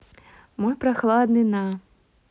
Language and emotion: Russian, neutral